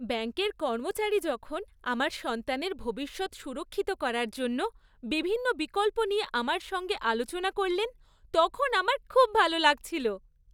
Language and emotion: Bengali, happy